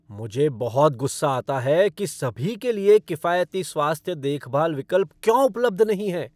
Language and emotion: Hindi, angry